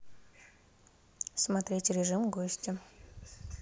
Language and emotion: Russian, neutral